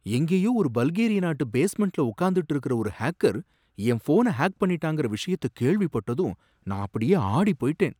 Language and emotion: Tamil, surprised